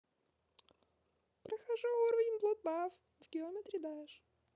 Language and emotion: Russian, positive